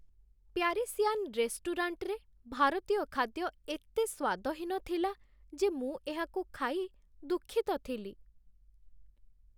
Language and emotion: Odia, sad